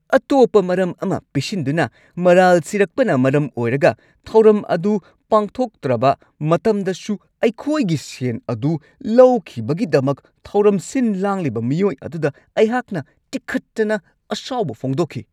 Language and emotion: Manipuri, angry